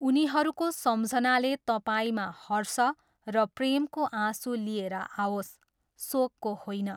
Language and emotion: Nepali, neutral